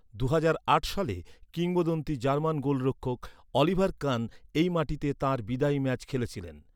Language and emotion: Bengali, neutral